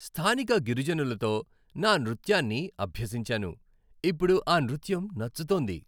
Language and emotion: Telugu, happy